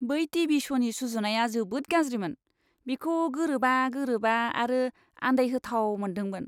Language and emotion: Bodo, disgusted